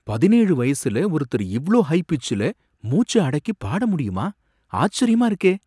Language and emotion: Tamil, surprised